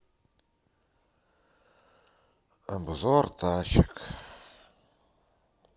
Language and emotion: Russian, sad